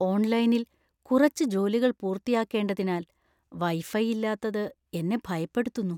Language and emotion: Malayalam, fearful